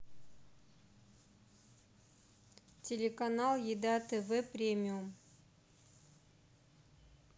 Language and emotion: Russian, neutral